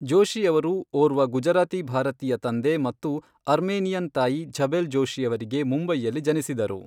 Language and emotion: Kannada, neutral